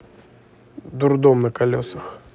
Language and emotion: Russian, neutral